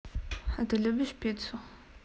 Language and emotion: Russian, neutral